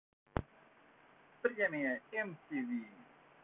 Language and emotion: Russian, positive